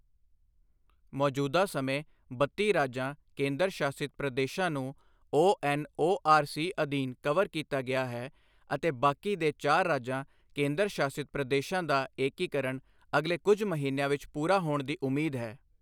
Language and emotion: Punjabi, neutral